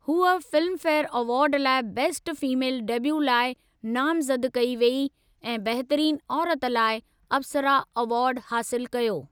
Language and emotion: Sindhi, neutral